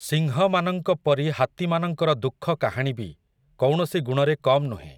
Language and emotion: Odia, neutral